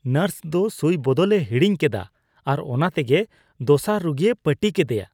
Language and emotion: Santali, disgusted